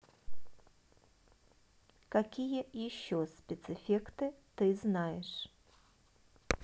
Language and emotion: Russian, neutral